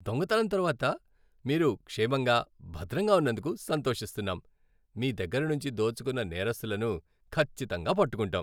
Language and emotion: Telugu, happy